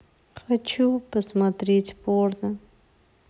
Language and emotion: Russian, sad